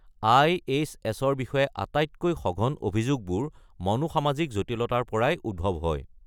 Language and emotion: Assamese, neutral